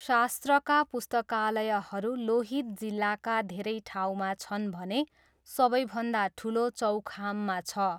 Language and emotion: Nepali, neutral